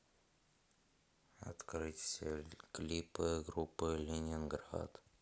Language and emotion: Russian, sad